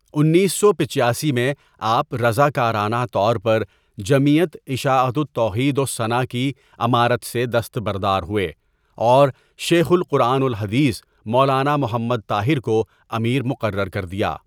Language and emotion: Urdu, neutral